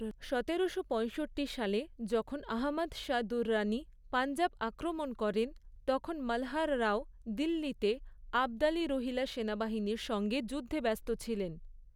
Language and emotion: Bengali, neutral